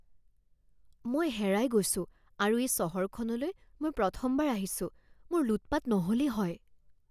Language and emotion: Assamese, fearful